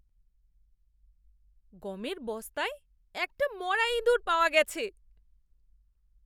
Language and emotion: Bengali, disgusted